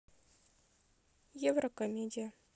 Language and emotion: Russian, neutral